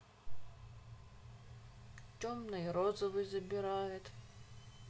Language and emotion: Russian, sad